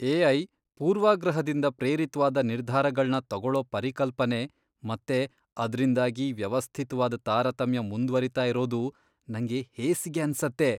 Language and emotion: Kannada, disgusted